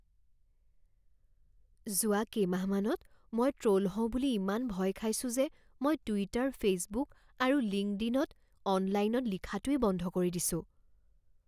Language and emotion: Assamese, fearful